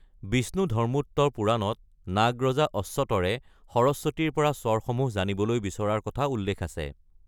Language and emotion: Assamese, neutral